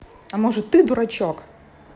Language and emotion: Russian, neutral